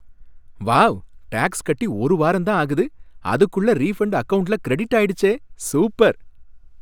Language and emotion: Tamil, happy